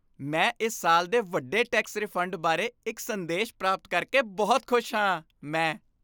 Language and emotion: Punjabi, happy